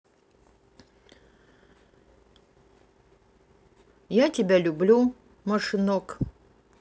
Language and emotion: Russian, neutral